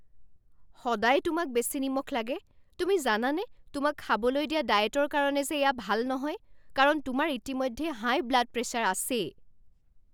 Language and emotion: Assamese, angry